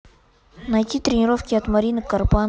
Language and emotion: Russian, neutral